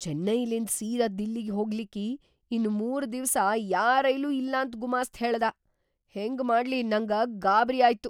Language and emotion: Kannada, surprised